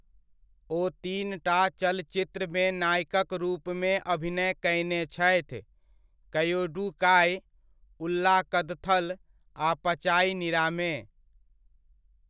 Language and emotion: Maithili, neutral